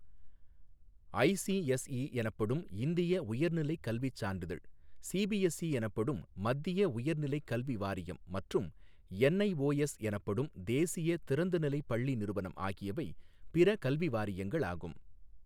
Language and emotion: Tamil, neutral